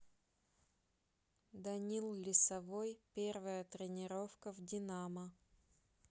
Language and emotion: Russian, neutral